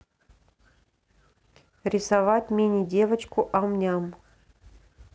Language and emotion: Russian, neutral